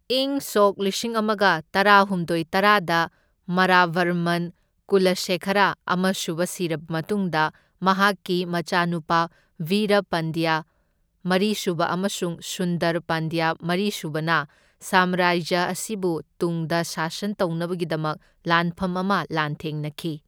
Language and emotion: Manipuri, neutral